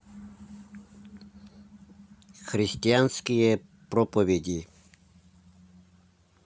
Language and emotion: Russian, neutral